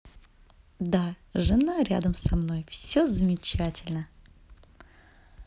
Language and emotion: Russian, positive